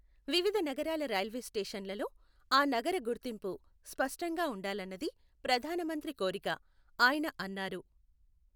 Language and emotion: Telugu, neutral